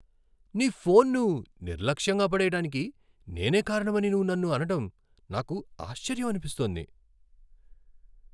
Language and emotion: Telugu, surprised